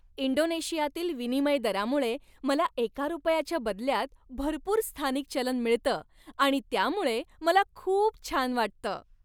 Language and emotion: Marathi, happy